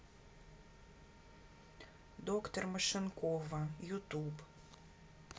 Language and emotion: Russian, neutral